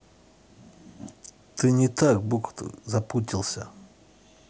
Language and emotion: Russian, neutral